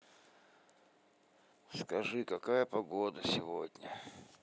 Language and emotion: Russian, sad